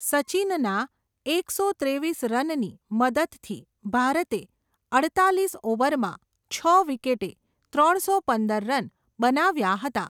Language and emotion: Gujarati, neutral